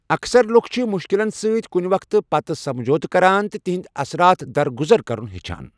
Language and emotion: Kashmiri, neutral